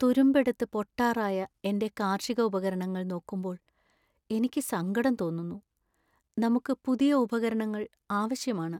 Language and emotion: Malayalam, sad